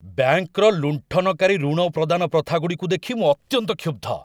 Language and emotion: Odia, angry